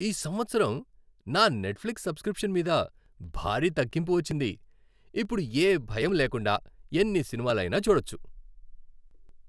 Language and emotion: Telugu, happy